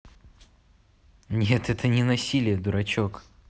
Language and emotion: Russian, positive